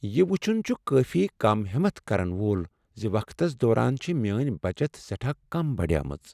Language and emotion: Kashmiri, sad